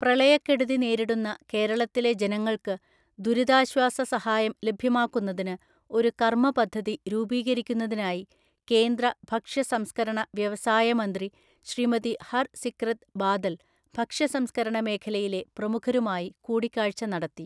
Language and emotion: Malayalam, neutral